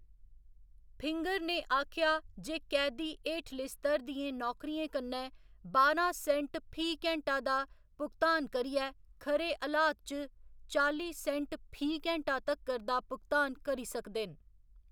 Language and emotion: Dogri, neutral